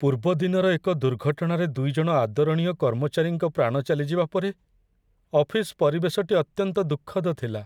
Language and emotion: Odia, sad